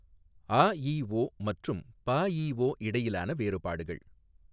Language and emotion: Tamil, neutral